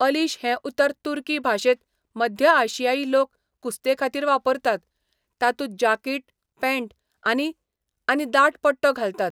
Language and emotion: Goan Konkani, neutral